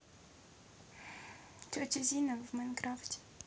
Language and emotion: Russian, neutral